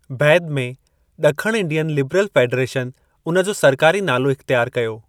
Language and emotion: Sindhi, neutral